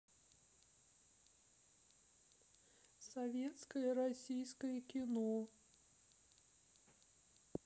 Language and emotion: Russian, sad